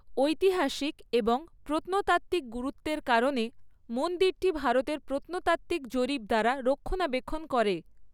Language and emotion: Bengali, neutral